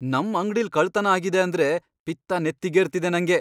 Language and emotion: Kannada, angry